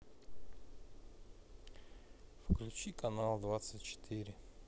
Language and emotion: Russian, sad